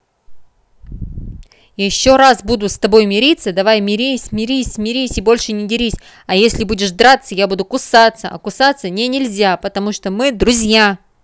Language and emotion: Russian, angry